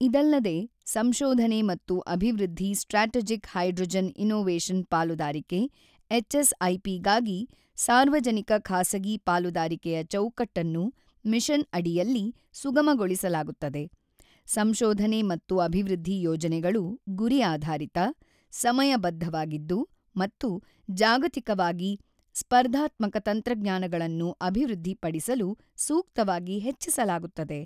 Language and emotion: Kannada, neutral